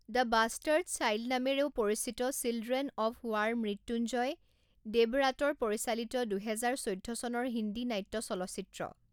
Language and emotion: Assamese, neutral